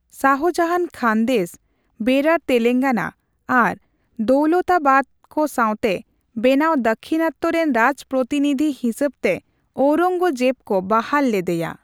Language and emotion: Santali, neutral